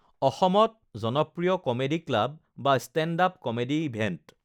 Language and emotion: Assamese, neutral